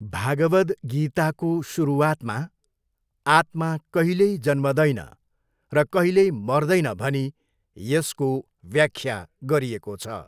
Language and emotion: Nepali, neutral